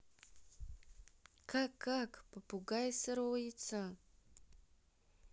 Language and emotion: Russian, neutral